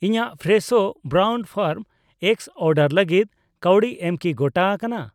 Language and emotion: Santali, neutral